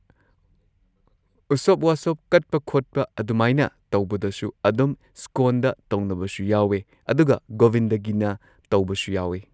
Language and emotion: Manipuri, neutral